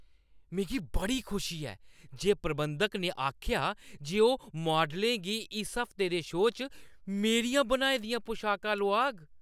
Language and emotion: Dogri, happy